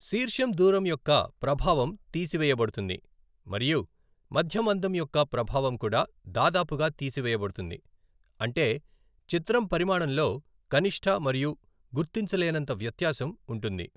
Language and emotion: Telugu, neutral